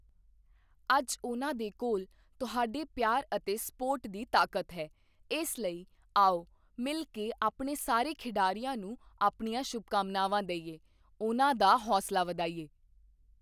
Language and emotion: Punjabi, neutral